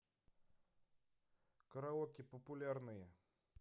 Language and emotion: Russian, neutral